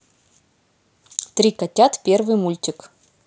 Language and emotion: Russian, positive